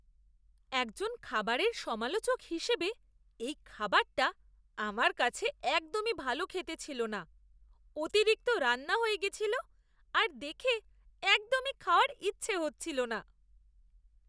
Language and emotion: Bengali, disgusted